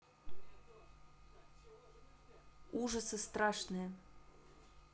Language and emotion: Russian, neutral